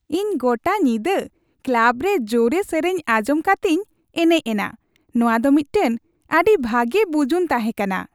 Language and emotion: Santali, happy